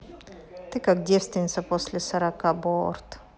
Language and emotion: Russian, neutral